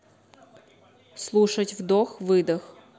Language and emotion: Russian, neutral